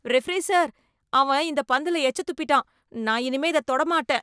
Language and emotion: Tamil, disgusted